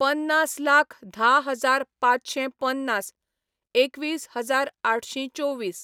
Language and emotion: Goan Konkani, neutral